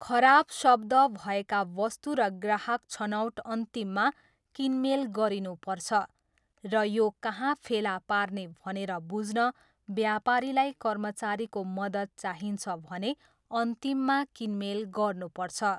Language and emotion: Nepali, neutral